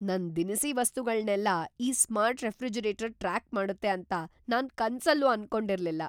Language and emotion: Kannada, surprised